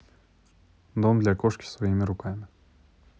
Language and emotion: Russian, neutral